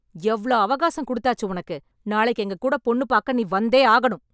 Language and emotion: Tamil, angry